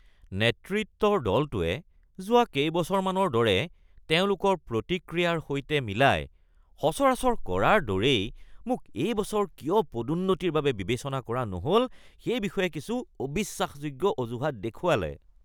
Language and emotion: Assamese, disgusted